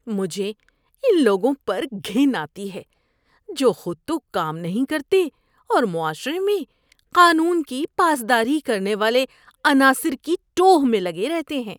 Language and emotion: Urdu, disgusted